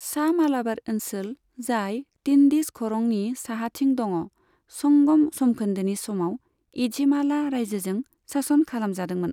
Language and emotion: Bodo, neutral